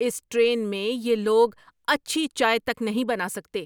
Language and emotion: Urdu, angry